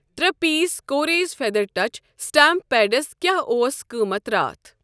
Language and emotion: Kashmiri, neutral